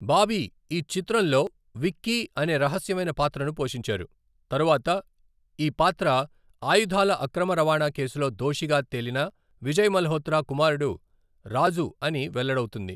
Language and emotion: Telugu, neutral